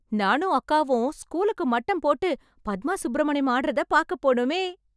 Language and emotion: Tamil, happy